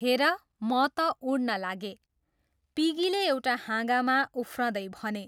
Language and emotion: Nepali, neutral